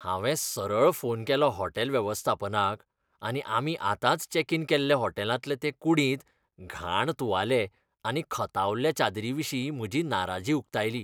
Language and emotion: Goan Konkani, disgusted